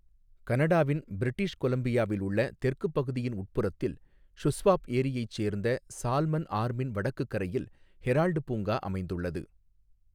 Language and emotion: Tamil, neutral